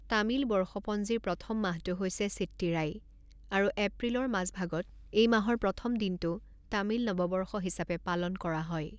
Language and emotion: Assamese, neutral